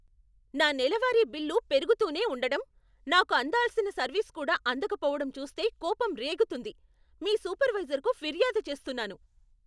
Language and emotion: Telugu, angry